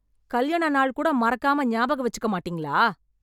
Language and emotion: Tamil, angry